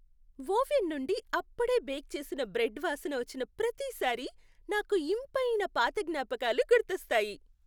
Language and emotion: Telugu, happy